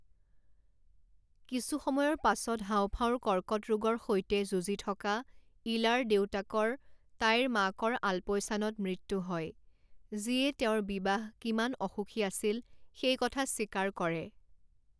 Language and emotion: Assamese, neutral